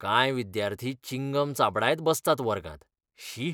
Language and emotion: Goan Konkani, disgusted